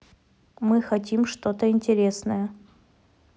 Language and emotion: Russian, neutral